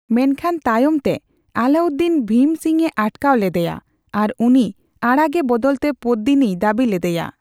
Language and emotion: Santali, neutral